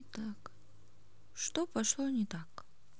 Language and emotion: Russian, neutral